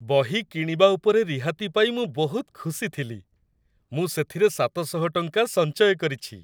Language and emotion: Odia, happy